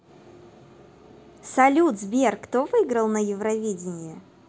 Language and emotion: Russian, positive